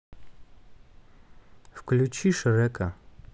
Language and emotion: Russian, neutral